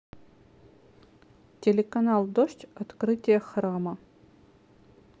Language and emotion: Russian, neutral